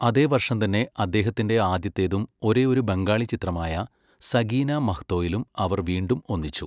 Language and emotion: Malayalam, neutral